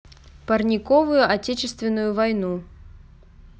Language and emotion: Russian, neutral